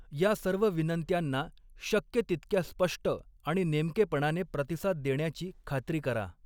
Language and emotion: Marathi, neutral